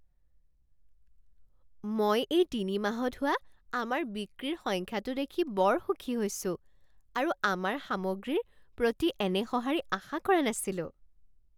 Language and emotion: Assamese, surprised